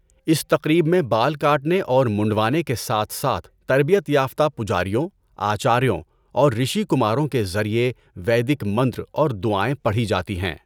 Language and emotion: Urdu, neutral